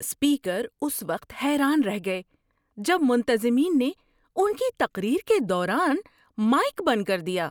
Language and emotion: Urdu, surprised